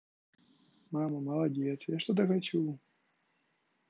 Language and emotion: Russian, positive